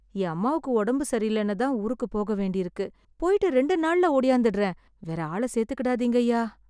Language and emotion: Tamil, fearful